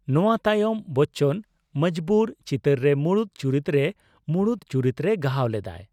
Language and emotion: Santali, neutral